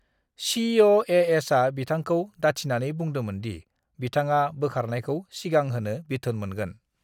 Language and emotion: Bodo, neutral